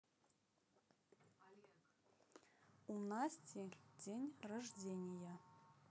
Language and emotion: Russian, neutral